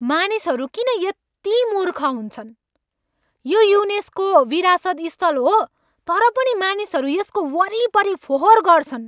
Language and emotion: Nepali, angry